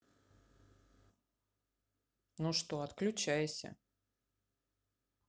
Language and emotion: Russian, neutral